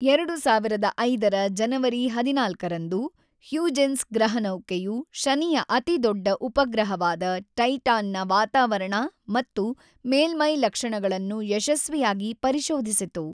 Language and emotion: Kannada, neutral